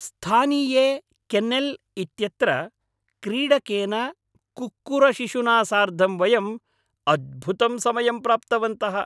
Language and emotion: Sanskrit, happy